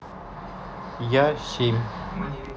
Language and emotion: Russian, neutral